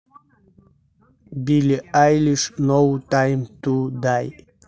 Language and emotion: Russian, neutral